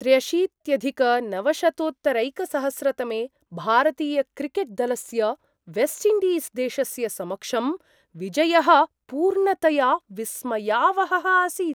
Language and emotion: Sanskrit, surprised